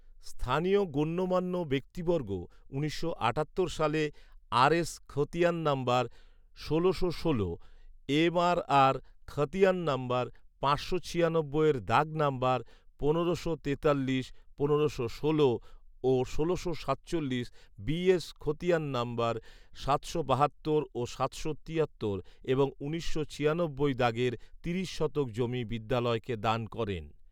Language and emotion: Bengali, neutral